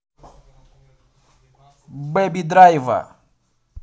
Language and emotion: Russian, positive